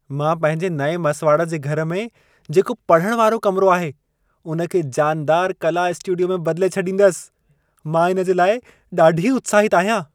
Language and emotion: Sindhi, happy